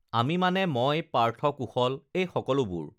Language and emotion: Assamese, neutral